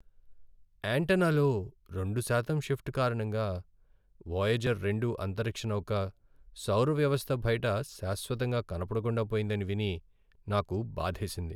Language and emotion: Telugu, sad